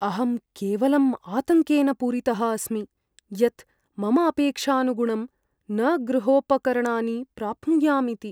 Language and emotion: Sanskrit, fearful